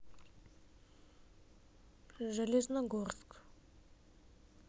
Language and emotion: Russian, neutral